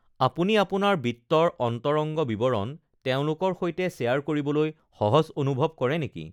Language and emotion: Assamese, neutral